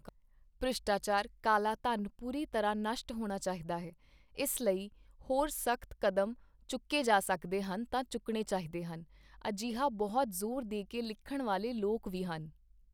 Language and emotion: Punjabi, neutral